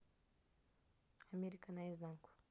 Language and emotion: Russian, neutral